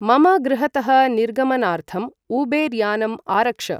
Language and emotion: Sanskrit, neutral